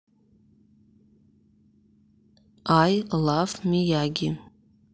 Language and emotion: Russian, neutral